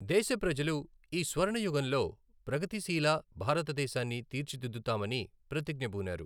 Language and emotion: Telugu, neutral